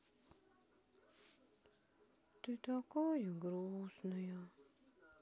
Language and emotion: Russian, sad